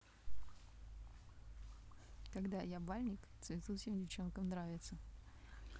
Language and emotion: Russian, neutral